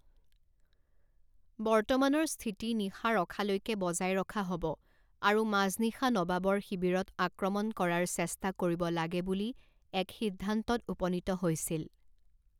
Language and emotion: Assamese, neutral